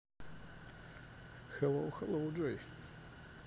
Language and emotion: Russian, neutral